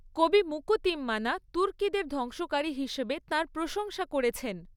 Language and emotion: Bengali, neutral